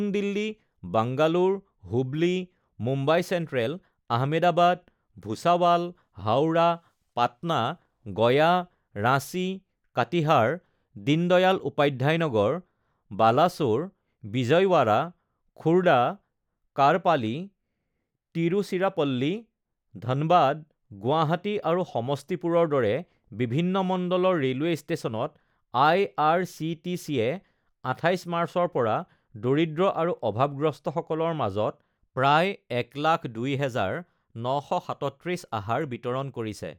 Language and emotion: Assamese, neutral